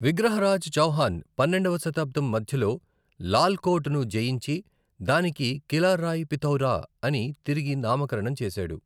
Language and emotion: Telugu, neutral